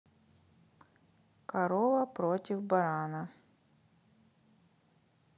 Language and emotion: Russian, neutral